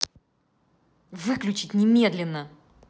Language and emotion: Russian, angry